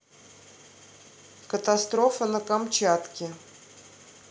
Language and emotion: Russian, neutral